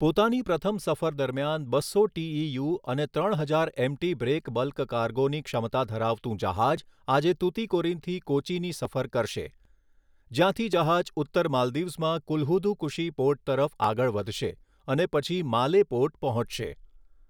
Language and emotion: Gujarati, neutral